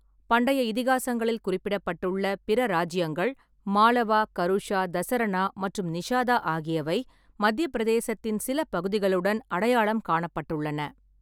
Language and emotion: Tamil, neutral